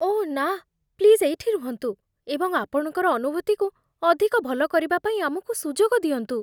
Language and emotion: Odia, fearful